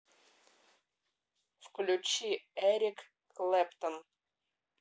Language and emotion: Russian, neutral